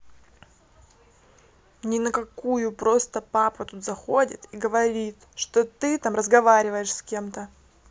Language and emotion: Russian, angry